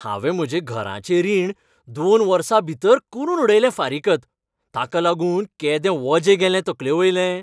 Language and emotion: Goan Konkani, happy